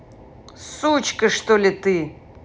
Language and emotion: Russian, angry